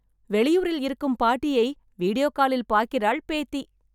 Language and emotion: Tamil, happy